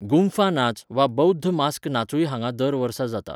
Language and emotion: Goan Konkani, neutral